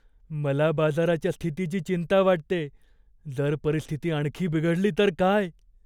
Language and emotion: Marathi, fearful